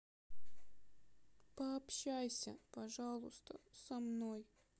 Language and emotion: Russian, sad